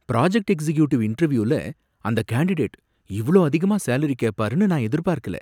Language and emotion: Tamil, surprised